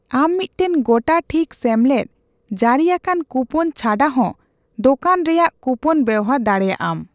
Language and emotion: Santali, neutral